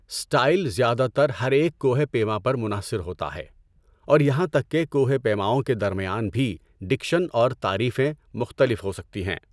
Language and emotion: Urdu, neutral